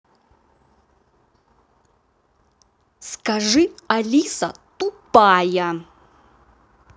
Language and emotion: Russian, angry